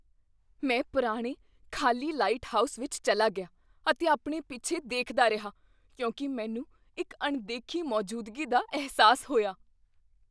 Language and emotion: Punjabi, fearful